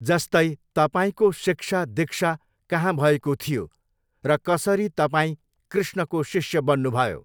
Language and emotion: Nepali, neutral